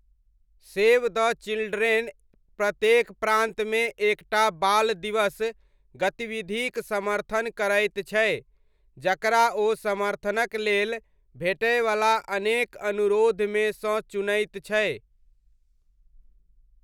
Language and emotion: Maithili, neutral